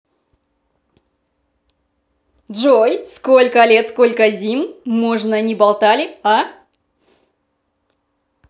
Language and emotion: Russian, positive